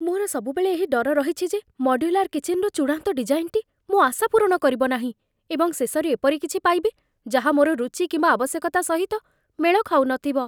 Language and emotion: Odia, fearful